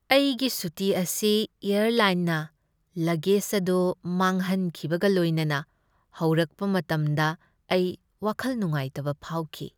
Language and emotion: Manipuri, sad